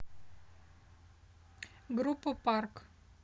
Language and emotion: Russian, neutral